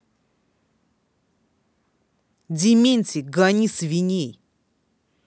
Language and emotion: Russian, angry